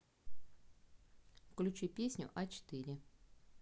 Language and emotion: Russian, neutral